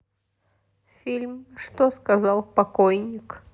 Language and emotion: Russian, sad